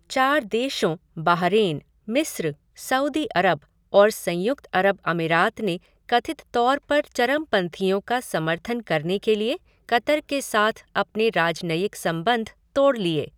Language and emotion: Hindi, neutral